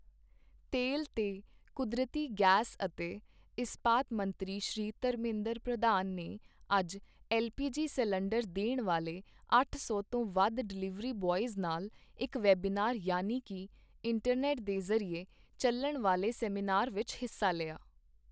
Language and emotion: Punjabi, neutral